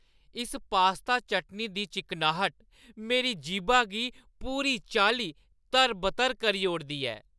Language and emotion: Dogri, happy